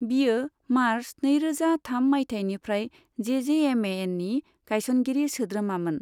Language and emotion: Bodo, neutral